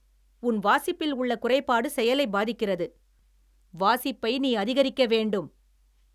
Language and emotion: Tamil, angry